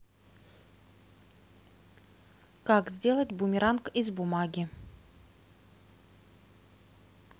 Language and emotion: Russian, neutral